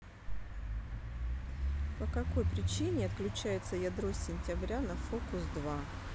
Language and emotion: Russian, neutral